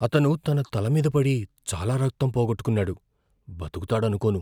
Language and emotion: Telugu, fearful